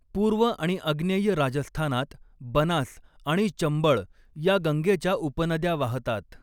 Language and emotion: Marathi, neutral